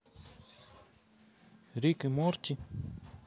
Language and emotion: Russian, neutral